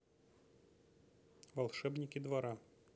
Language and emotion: Russian, neutral